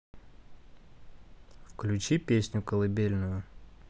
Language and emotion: Russian, neutral